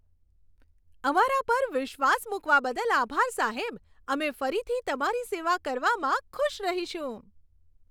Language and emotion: Gujarati, happy